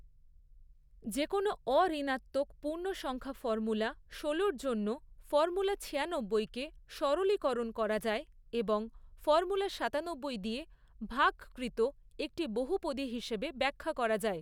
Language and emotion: Bengali, neutral